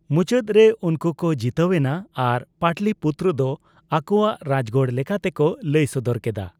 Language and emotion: Santali, neutral